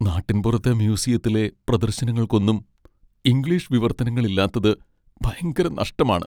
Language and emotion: Malayalam, sad